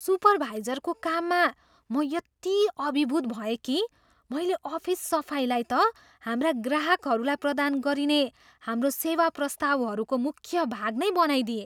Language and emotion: Nepali, surprised